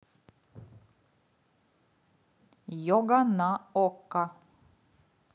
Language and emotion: Russian, neutral